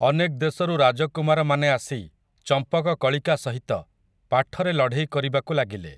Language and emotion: Odia, neutral